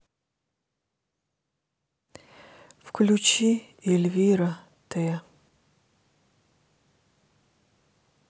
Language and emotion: Russian, sad